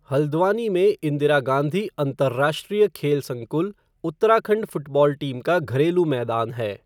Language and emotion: Hindi, neutral